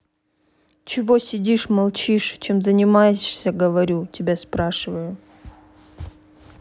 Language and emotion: Russian, angry